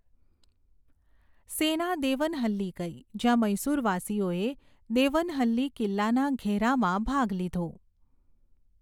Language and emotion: Gujarati, neutral